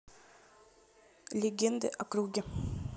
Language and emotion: Russian, neutral